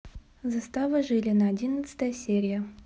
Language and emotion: Russian, neutral